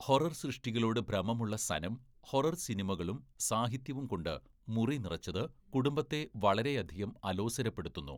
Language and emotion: Malayalam, neutral